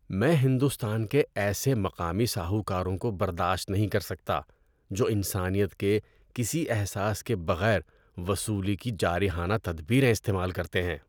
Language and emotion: Urdu, disgusted